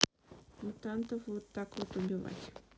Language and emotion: Russian, neutral